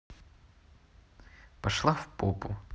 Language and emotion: Russian, neutral